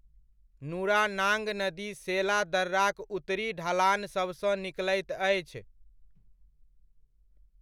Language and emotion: Maithili, neutral